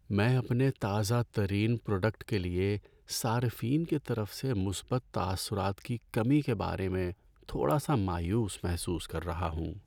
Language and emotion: Urdu, sad